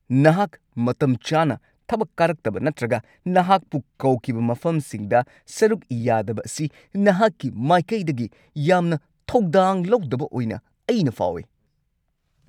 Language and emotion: Manipuri, angry